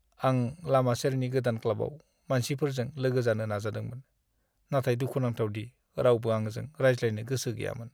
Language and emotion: Bodo, sad